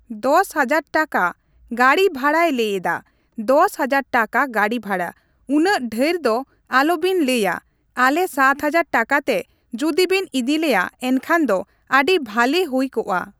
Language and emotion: Santali, neutral